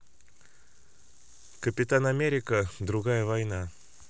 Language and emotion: Russian, neutral